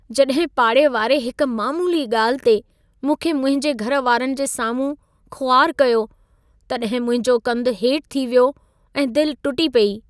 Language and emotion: Sindhi, sad